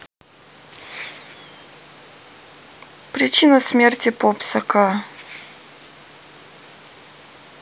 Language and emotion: Russian, neutral